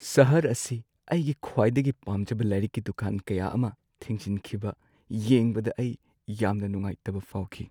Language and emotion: Manipuri, sad